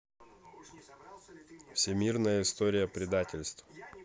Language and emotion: Russian, neutral